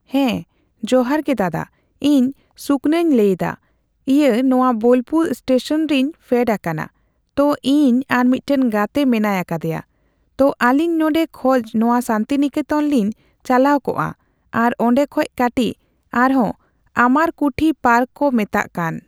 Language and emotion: Santali, neutral